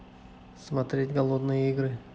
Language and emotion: Russian, neutral